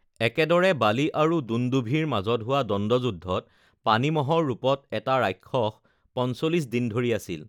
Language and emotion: Assamese, neutral